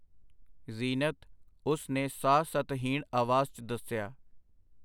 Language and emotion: Punjabi, neutral